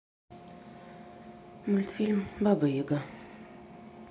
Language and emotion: Russian, sad